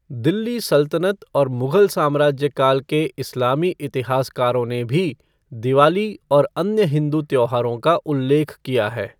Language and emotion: Hindi, neutral